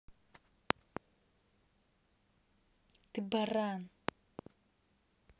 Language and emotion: Russian, angry